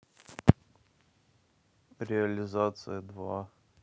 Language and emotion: Russian, neutral